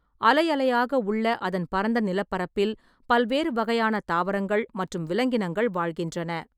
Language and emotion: Tamil, neutral